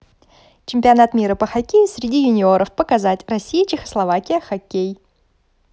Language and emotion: Russian, positive